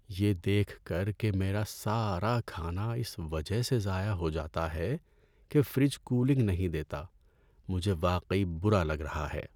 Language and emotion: Urdu, sad